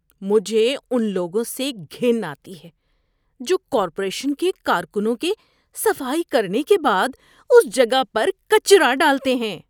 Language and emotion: Urdu, disgusted